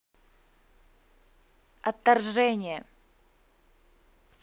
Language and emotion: Russian, angry